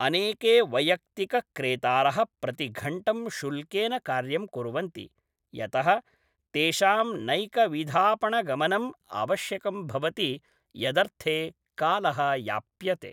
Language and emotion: Sanskrit, neutral